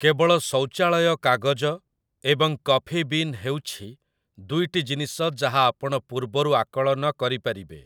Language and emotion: Odia, neutral